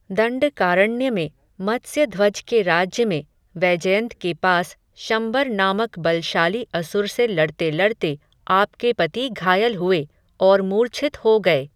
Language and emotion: Hindi, neutral